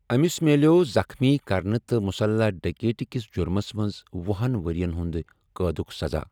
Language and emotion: Kashmiri, neutral